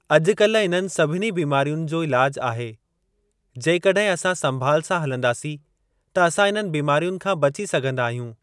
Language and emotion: Sindhi, neutral